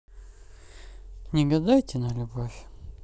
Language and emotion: Russian, neutral